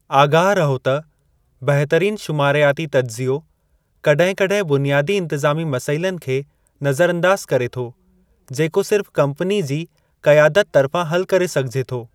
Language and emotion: Sindhi, neutral